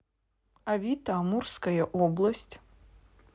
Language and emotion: Russian, neutral